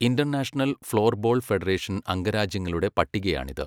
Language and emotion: Malayalam, neutral